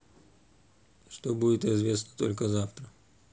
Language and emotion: Russian, neutral